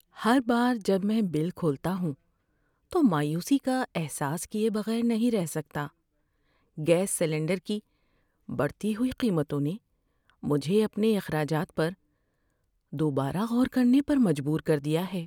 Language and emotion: Urdu, sad